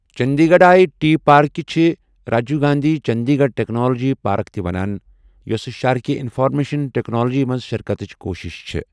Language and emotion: Kashmiri, neutral